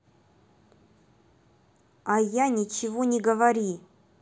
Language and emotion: Russian, angry